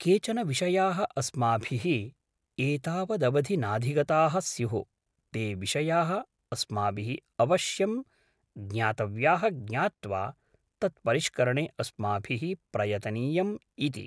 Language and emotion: Sanskrit, neutral